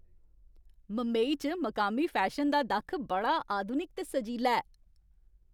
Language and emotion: Dogri, happy